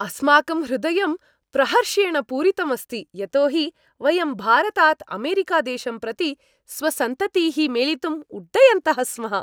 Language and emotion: Sanskrit, happy